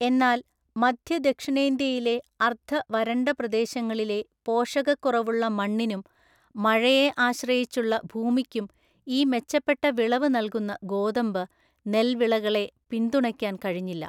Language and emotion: Malayalam, neutral